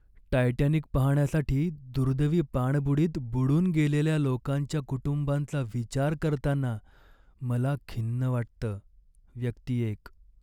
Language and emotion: Marathi, sad